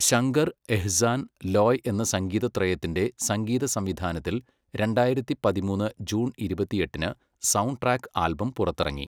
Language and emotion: Malayalam, neutral